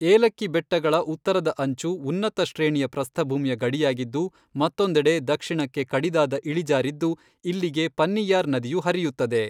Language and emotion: Kannada, neutral